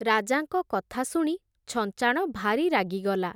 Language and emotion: Odia, neutral